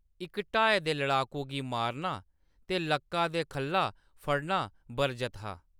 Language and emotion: Dogri, neutral